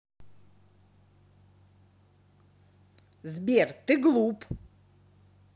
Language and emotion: Russian, angry